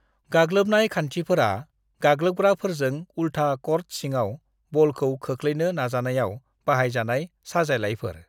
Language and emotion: Bodo, neutral